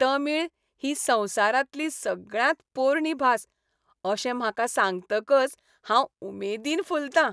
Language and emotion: Goan Konkani, happy